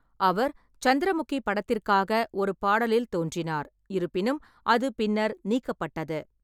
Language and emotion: Tamil, neutral